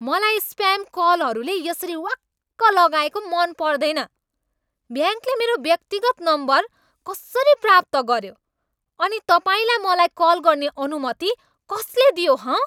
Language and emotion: Nepali, angry